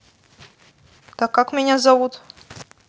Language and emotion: Russian, neutral